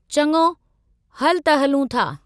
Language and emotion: Sindhi, neutral